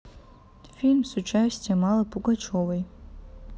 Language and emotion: Russian, neutral